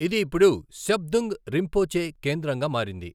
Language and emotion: Telugu, neutral